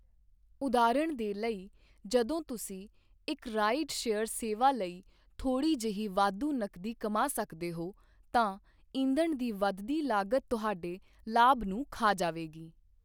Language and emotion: Punjabi, neutral